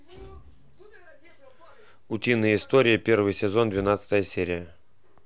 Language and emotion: Russian, neutral